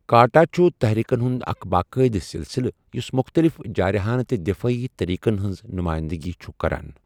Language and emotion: Kashmiri, neutral